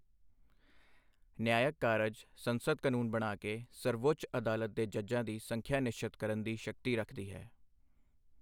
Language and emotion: Punjabi, neutral